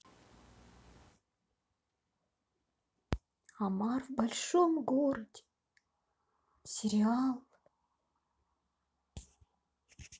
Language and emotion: Russian, sad